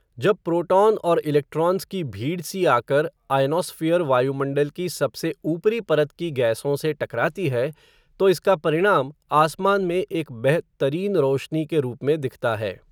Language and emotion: Hindi, neutral